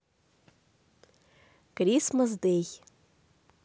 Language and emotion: Russian, positive